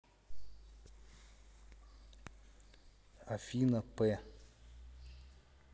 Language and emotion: Russian, neutral